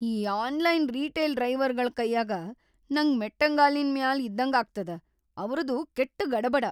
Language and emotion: Kannada, fearful